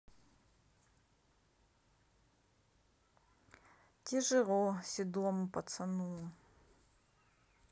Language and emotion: Russian, sad